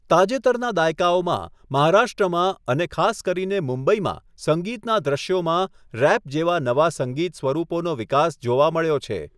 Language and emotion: Gujarati, neutral